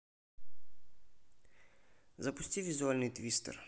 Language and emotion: Russian, neutral